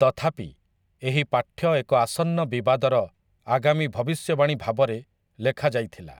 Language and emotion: Odia, neutral